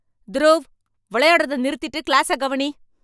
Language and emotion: Tamil, angry